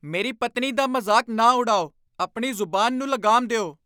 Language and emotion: Punjabi, angry